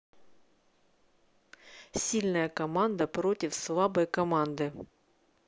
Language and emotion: Russian, neutral